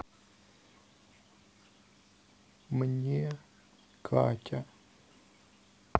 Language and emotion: Russian, sad